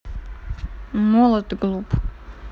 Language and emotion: Russian, neutral